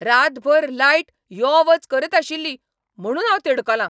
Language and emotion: Goan Konkani, angry